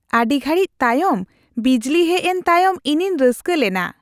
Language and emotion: Santali, happy